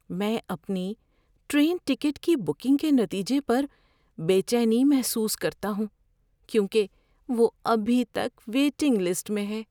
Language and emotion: Urdu, fearful